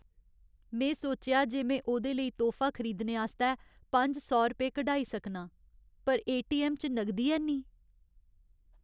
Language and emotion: Dogri, sad